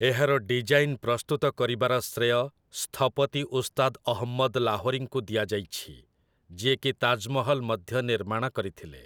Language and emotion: Odia, neutral